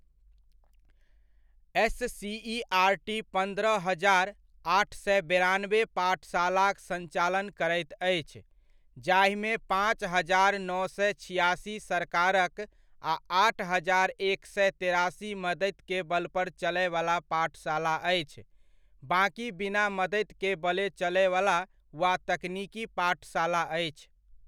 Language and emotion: Maithili, neutral